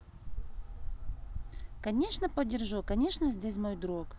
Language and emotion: Russian, positive